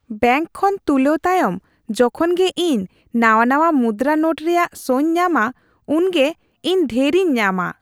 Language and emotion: Santali, happy